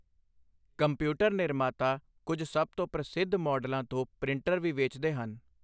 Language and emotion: Punjabi, neutral